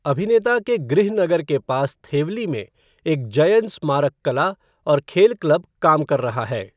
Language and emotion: Hindi, neutral